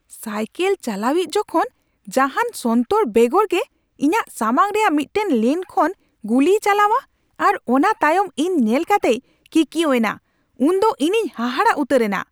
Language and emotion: Santali, angry